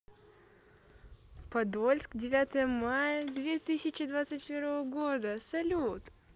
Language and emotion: Russian, positive